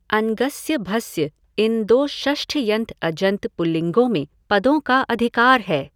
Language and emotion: Hindi, neutral